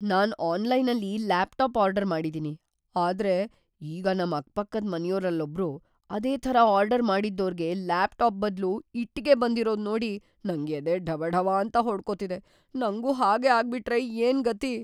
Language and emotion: Kannada, fearful